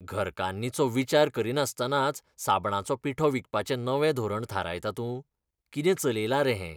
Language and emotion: Goan Konkani, disgusted